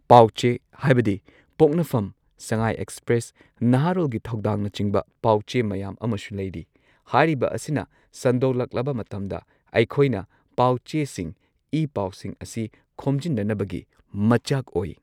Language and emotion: Manipuri, neutral